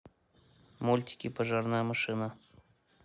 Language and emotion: Russian, neutral